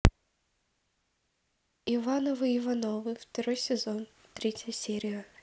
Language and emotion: Russian, neutral